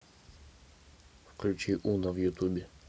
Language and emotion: Russian, neutral